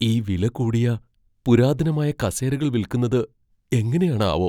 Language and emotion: Malayalam, fearful